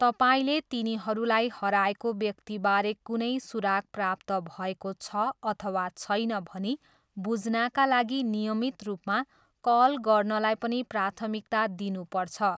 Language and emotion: Nepali, neutral